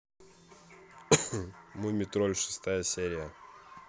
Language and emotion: Russian, neutral